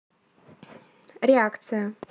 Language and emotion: Russian, neutral